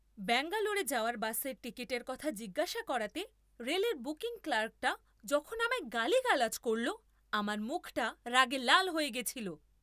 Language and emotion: Bengali, angry